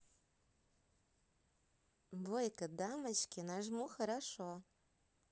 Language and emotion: Russian, positive